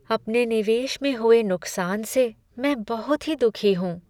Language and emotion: Hindi, sad